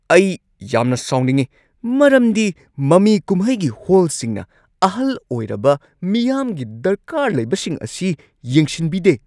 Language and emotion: Manipuri, angry